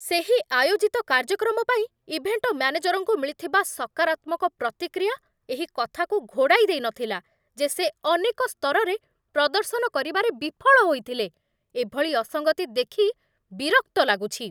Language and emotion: Odia, angry